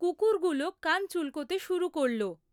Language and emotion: Bengali, neutral